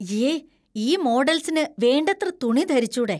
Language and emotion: Malayalam, disgusted